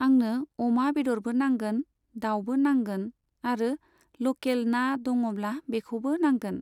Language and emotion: Bodo, neutral